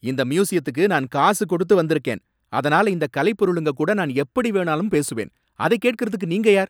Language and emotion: Tamil, angry